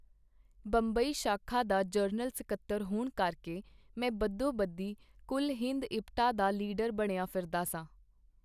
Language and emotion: Punjabi, neutral